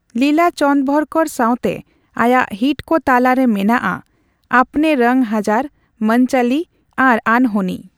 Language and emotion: Santali, neutral